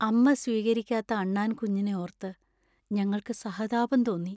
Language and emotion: Malayalam, sad